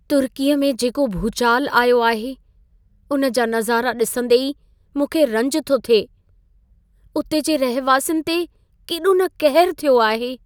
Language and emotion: Sindhi, sad